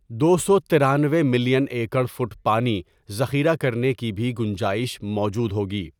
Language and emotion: Urdu, neutral